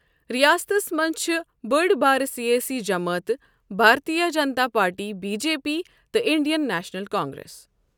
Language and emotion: Kashmiri, neutral